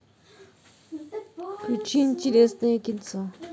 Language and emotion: Russian, neutral